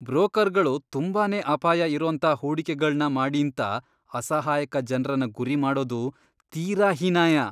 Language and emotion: Kannada, disgusted